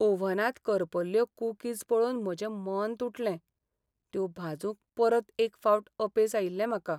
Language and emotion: Goan Konkani, sad